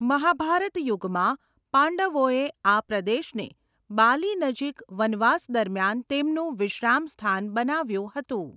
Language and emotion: Gujarati, neutral